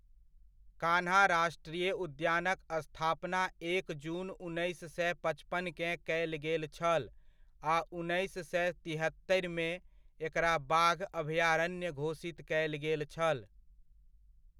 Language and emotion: Maithili, neutral